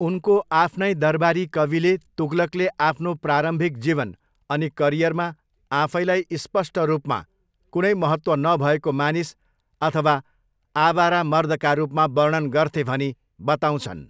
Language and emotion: Nepali, neutral